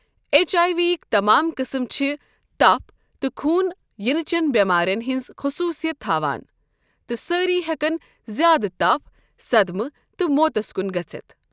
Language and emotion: Kashmiri, neutral